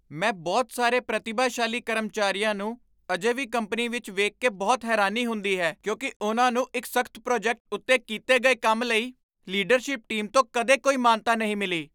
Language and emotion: Punjabi, surprised